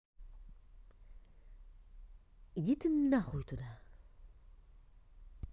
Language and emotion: Russian, angry